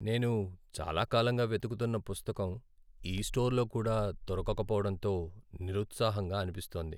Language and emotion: Telugu, sad